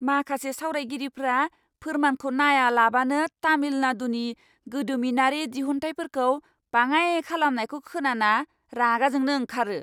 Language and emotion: Bodo, angry